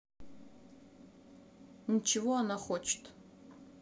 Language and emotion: Russian, neutral